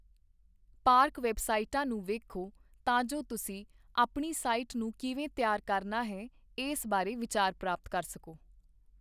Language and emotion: Punjabi, neutral